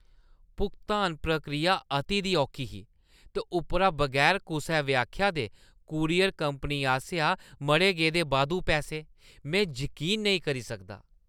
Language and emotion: Dogri, disgusted